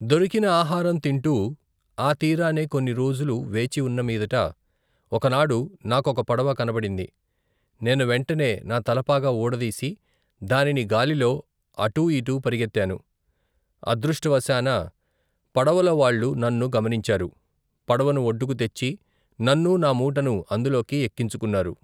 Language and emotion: Telugu, neutral